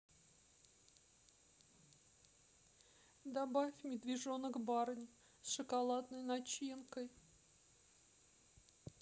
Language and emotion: Russian, sad